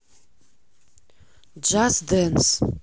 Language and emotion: Russian, neutral